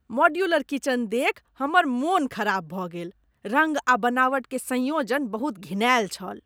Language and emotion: Maithili, disgusted